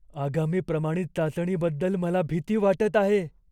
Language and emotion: Marathi, fearful